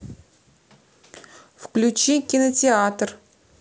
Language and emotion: Russian, neutral